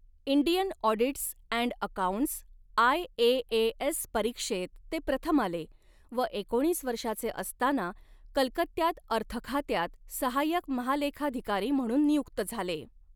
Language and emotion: Marathi, neutral